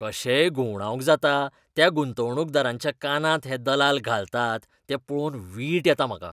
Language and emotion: Goan Konkani, disgusted